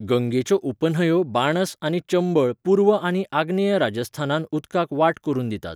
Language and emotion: Goan Konkani, neutral